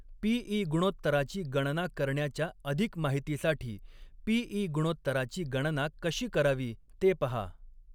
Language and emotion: Marathi, neutral